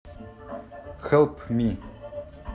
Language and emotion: Russian, neutral